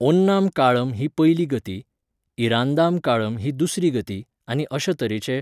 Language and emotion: Goan Konkani, neutral